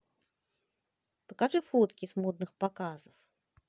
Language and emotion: Russian, positive